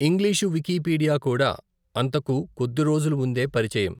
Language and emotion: Telugu, neutral